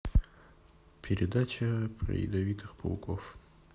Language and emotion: Russian, neutral